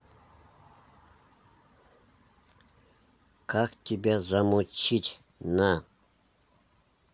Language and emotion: Russian, neutral